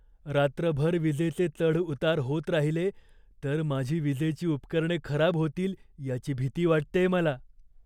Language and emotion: Marathi, fearful